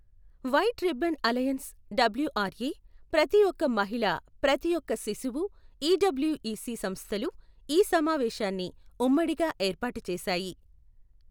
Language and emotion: Telugu, neutral